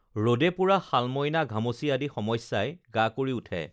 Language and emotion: Assamese, neutral